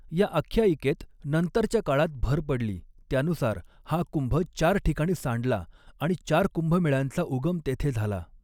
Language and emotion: Marathi, neutral